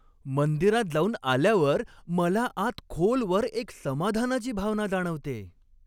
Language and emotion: Marathi, happy